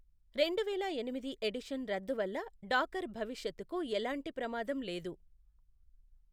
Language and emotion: Telugu, neutral